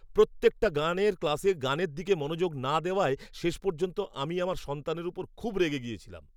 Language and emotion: Bengali, angry